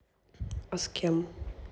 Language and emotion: Russian, neutral